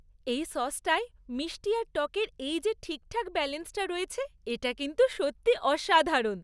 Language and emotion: Bengali, happy